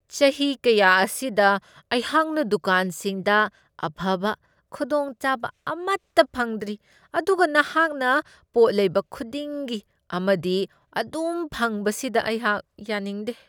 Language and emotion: Manipuri, disgusted